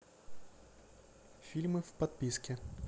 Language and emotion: Russian, neutral